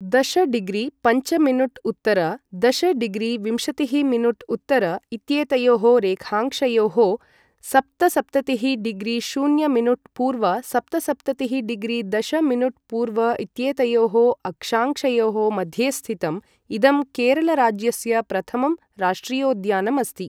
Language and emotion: Sanskrit, neutral